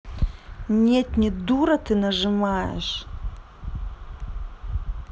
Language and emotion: Russian, angry